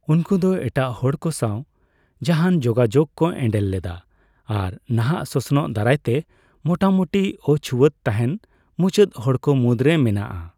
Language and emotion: Santali, neutral